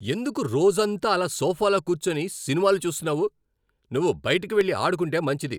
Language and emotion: Telugu, angry